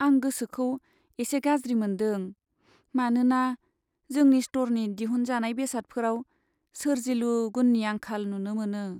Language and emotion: Bodo, sad